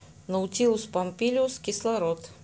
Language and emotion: Russian, neutral